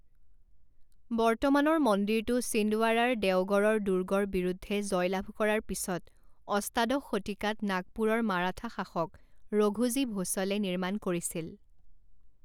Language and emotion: Assamese, neutral